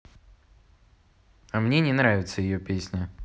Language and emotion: Russian, neutral